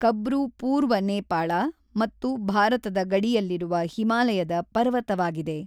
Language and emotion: Kannada, neutral